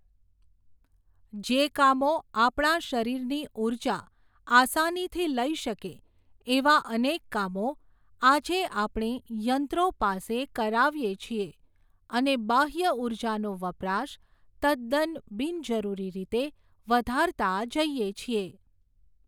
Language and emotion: Gujarati, neutral